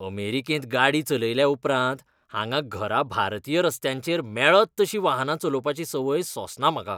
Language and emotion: Goan Konkani, disgusted